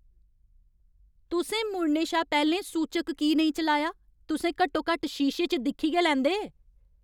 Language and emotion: Dogri, angry